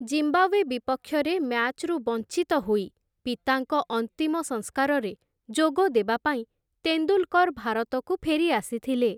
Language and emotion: Odia, neutral